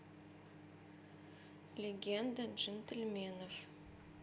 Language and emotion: Russian, neutral